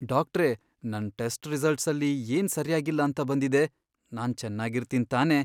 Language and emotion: Kannada, fearful